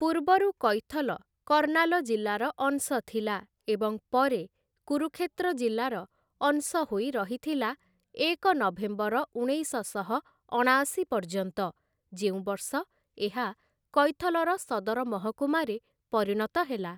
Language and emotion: Odia, neutral